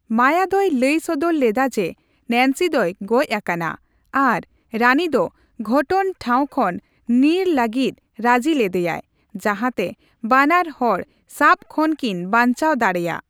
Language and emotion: Santali, neutral